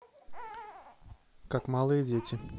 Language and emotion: Russian, neutral